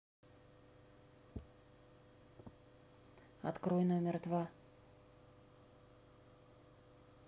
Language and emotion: Russian, neutral